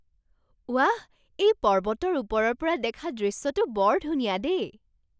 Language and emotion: Assamese, surprised